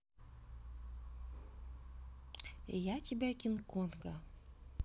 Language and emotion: Russian, neutral